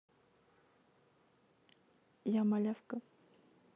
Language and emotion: Russian, neutral